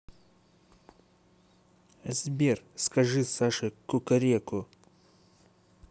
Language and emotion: Russian, neutral